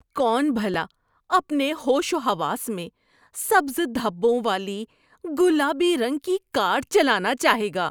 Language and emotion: Urdu, disgusted